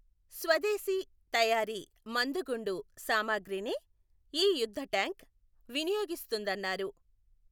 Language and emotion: Telugu, neutral